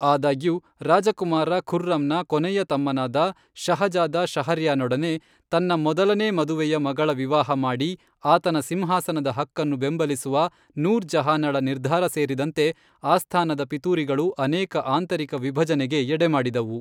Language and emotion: Kannada, neutral